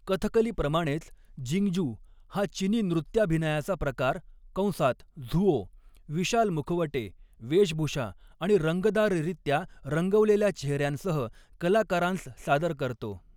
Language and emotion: Marathi, neutral